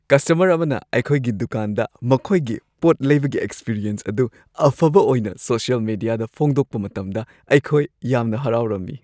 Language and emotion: Manipuri, happy